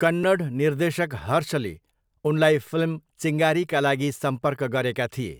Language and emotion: Nepali, neutral